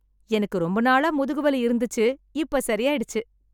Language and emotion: Tamil, happy